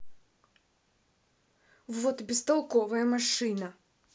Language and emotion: Russian, angry